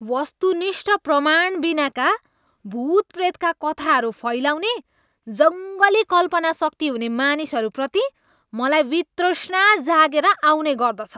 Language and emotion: Nepali, disgusted